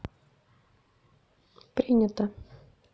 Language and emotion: Russian, neutral